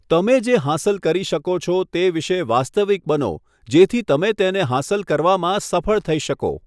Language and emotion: Gujarati, neutral